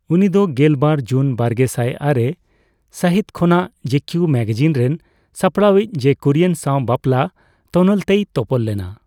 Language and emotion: Santali, neutral